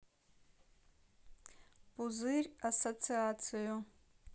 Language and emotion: Russian, neutral